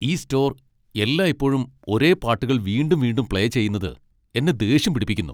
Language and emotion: Malayalam, angry